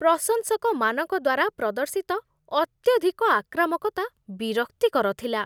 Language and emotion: Odia, disgusted